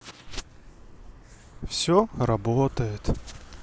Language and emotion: Russian, sad